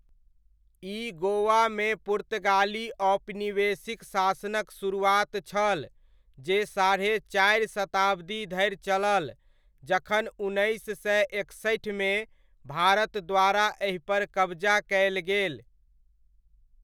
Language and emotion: Maithili, neutral